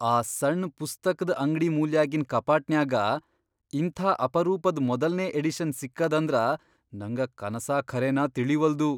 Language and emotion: Kannada, surprised